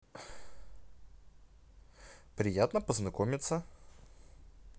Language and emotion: Russian, positive